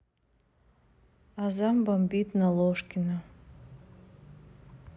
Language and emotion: Russian, sad